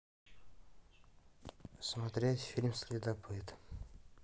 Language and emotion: Russian, neutral